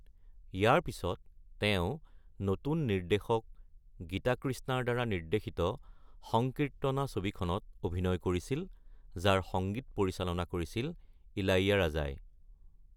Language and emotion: Assamese, neutral